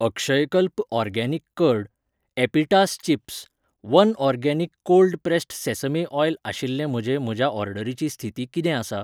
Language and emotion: Goan Konkani, neutral